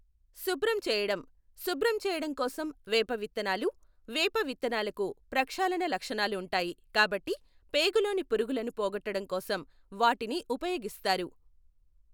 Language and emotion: Telugu, neutral